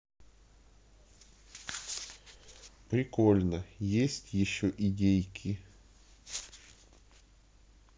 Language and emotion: Russian, neutral